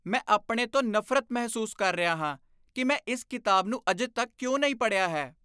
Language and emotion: Punjabi, disgusted